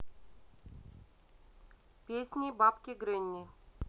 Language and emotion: Russian, neutral